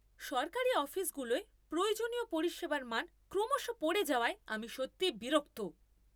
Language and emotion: Bengali, angry